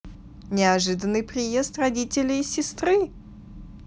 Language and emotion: Russian, positive